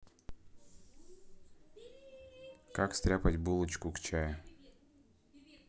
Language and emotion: Russian, neutral